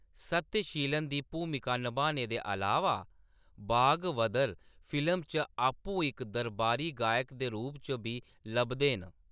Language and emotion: Dogri, neutral